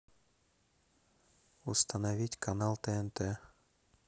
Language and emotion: Russian, neutral